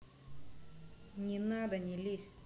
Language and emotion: Russian, angry